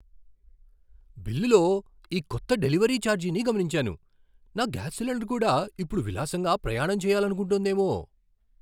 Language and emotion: Telugu, surprised